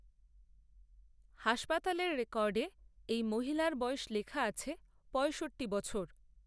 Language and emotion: Bengali, neutral